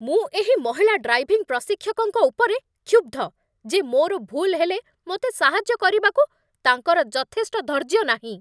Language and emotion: Odia, angry